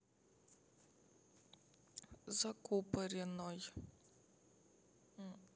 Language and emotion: Russian, sad